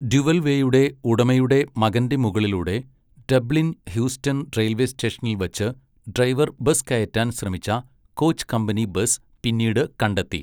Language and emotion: Malayalam, neutral